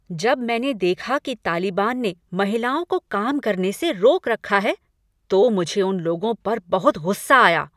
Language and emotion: Hindi, angry